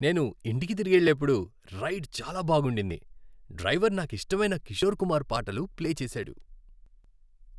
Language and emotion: Telugu, happy